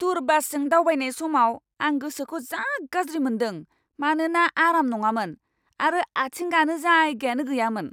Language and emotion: Bodo, angry